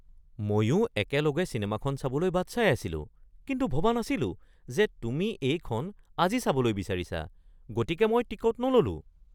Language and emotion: Assamese, surprised